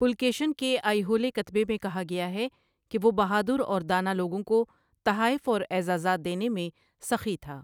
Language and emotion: Urdu, neutral